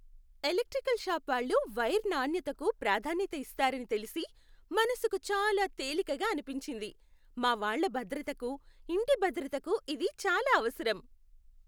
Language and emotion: Telugu, happy